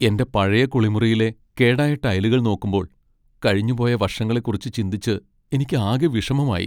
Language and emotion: Malayalam, sad